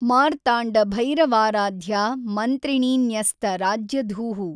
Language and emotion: Kannada, neutral